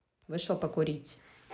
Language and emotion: Russian, neutral